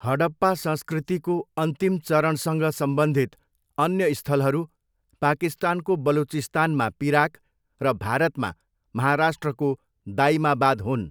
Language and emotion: Nepali, neutral